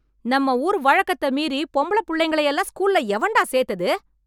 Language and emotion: Tamil, angry